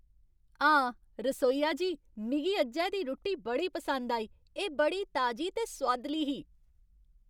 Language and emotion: Dogri, happy